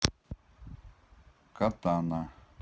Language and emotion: Russian, neutral